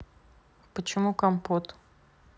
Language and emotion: Russian, neutral